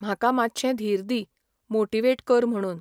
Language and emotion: Goan Konkani, neutral